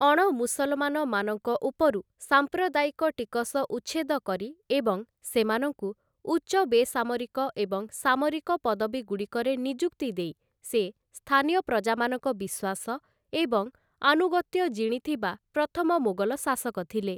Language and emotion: Odia, neutral